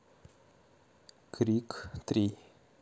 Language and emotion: Russian, neutral